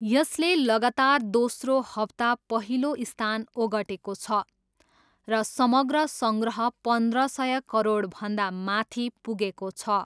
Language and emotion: Nepali, neutral